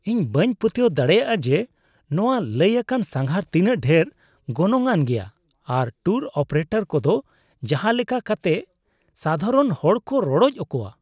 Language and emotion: Santali, disgusted